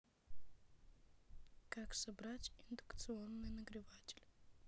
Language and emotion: Russian, neutral